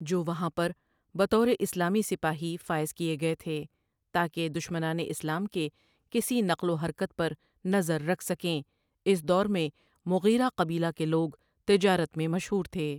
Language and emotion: Urdu, neutral